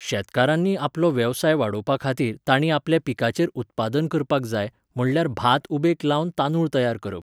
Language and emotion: Goan Konkani, neutral